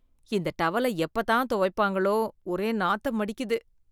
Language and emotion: Tamil, disgusted